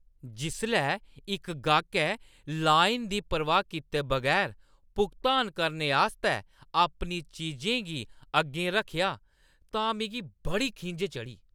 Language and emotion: Dogri, angry